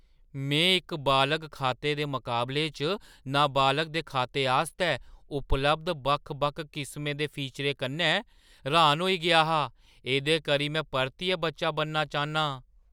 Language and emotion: Dogri, surprised